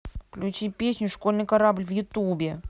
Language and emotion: Russian, neutral